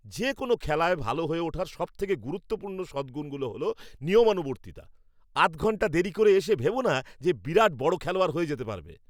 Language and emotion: Bengali, angry